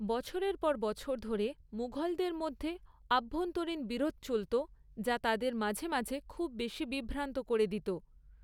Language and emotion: Bengali, neutral